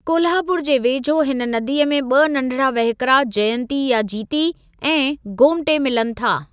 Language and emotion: Sindhi, neutral